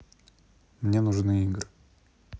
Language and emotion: Russian, neutral